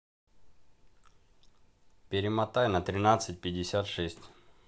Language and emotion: Russian, neutral